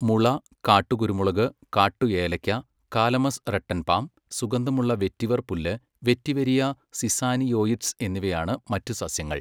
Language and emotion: Malayalam, neutral